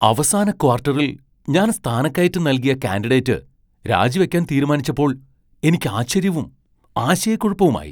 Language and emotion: Malayalam, surprised